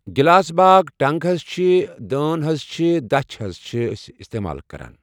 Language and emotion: Kashmiri, neutral